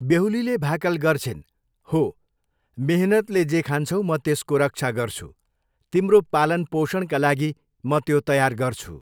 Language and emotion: Nepali, neutral